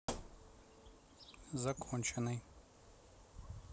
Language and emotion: Russian, neutral